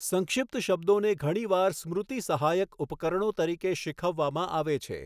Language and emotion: Gujarati, neutral